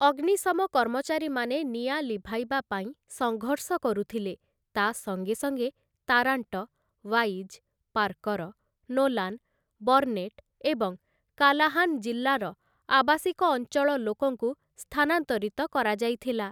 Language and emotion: Odia, neutral